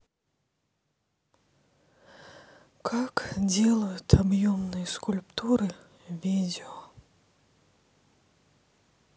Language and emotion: Russian, sad